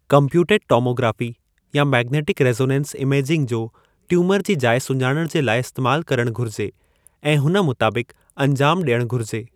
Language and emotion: Sindhi, neutral